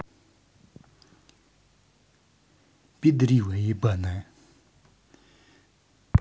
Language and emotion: Russian, angry